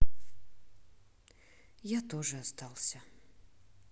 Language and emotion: Russian, neutral